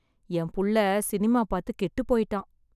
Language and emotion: Tamil, sad